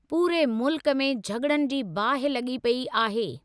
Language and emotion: Sindhi, neutral